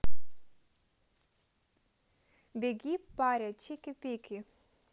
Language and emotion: Russian, neutral